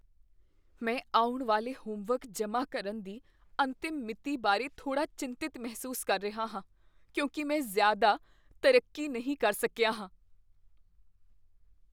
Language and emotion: Punjabi, fearful